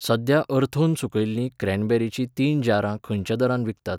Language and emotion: Goan Konkani, neutral